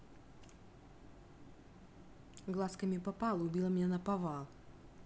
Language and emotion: Russian, neutral